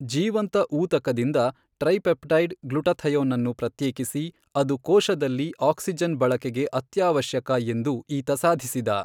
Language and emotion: Kannada, neutral